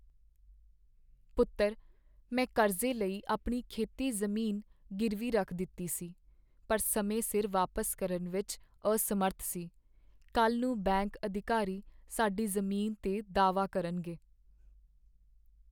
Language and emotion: Punjabi, sad